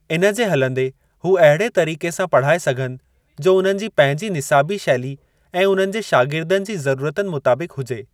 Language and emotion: Sindhi, neutral